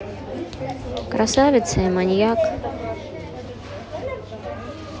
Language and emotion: Russian, neutral